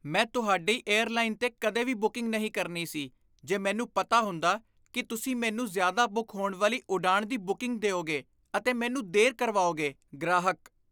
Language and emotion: Punjabi, disgusted